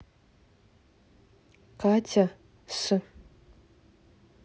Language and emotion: Russian, neutral